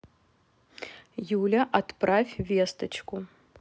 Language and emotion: Russian, neutral